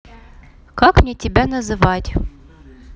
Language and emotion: Russian, neutral